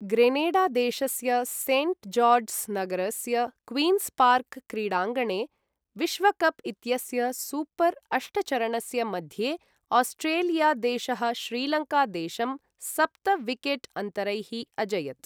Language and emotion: Sanskrit, neutral